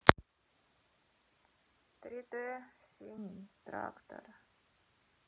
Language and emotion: Russian, sad